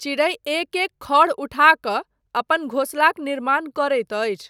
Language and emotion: Maithili, neutral